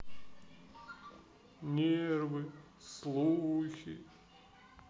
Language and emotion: Russian, sad